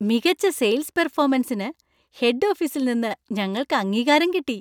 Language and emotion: Malayalam, happy